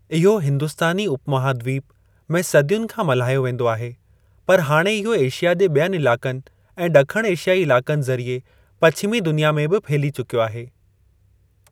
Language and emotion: Sindhi, neutral